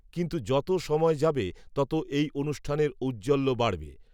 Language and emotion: Bengali, neutral